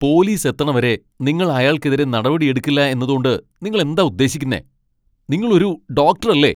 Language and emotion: Malayalam, angry